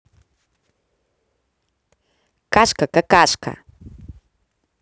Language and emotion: Russian, positive